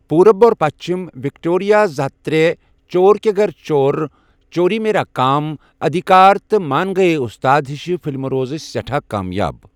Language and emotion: Kashmiri, neutral